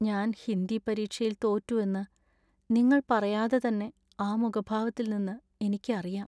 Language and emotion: Malayalam, sad